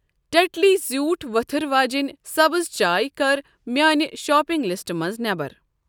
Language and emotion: Kashmiri, neutral